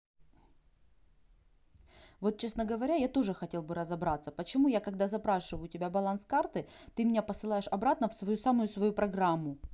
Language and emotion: Russian, angry